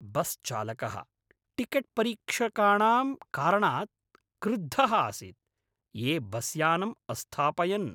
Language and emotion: Sanskrit, angry